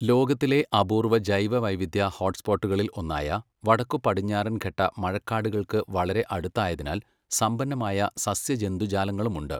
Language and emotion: Malayalam, neutral